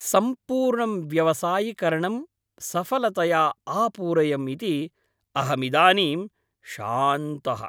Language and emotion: Sanskrit, happy